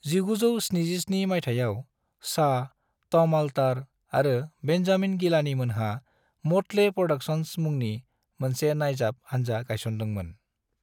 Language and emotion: Bodo, neutral